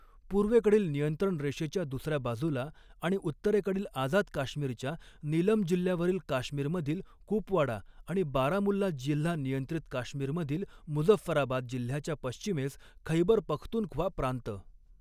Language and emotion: Marathi, neutral